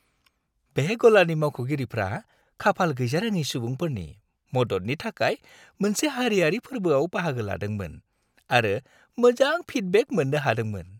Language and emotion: Bodo, happy